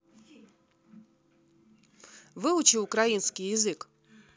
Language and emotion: Russian, neutral